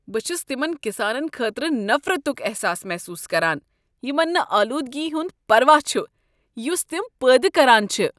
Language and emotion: Kashmiri, disgusted